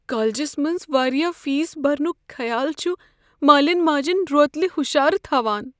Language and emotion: Kashmiri, fearful